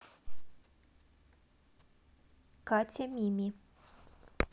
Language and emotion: Russian, neutral